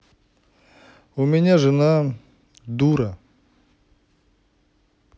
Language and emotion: Russian, angry